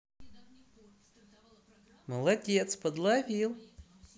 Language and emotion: Russian, positive